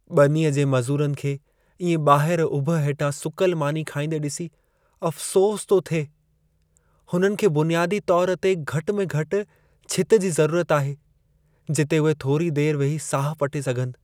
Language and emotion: Sindhi, sad